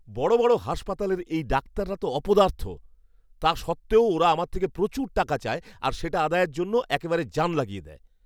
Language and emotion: Bengali, angry